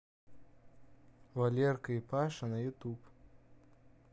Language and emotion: Russian, neutral